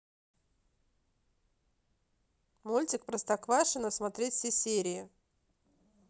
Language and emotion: Russian, neutral